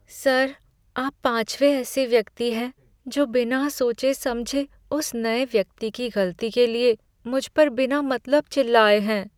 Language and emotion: Hindi, sad